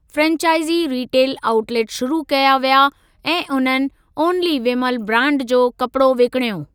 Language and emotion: Sindhi, neutral